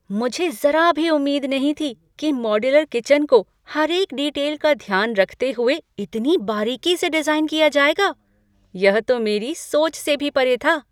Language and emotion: Hindi, surprised